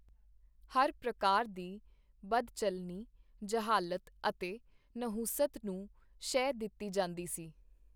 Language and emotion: Punjabi, neutral